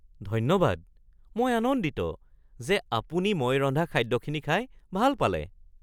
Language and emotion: Assamese, surprised